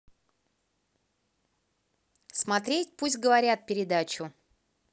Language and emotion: Russian, neutral